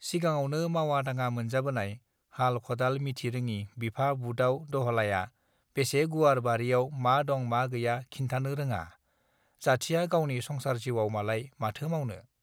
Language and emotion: Bodo, neutral